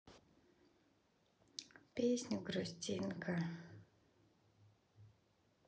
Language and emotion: Russian, sad